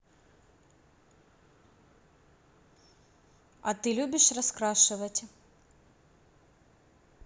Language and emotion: Russian, neutral